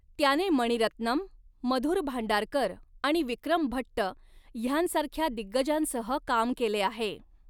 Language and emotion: Marathi, neutral